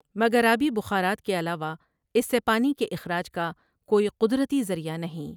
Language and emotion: Urdu, neutral